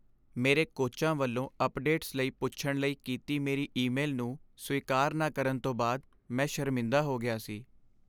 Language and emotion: Punjabi, sad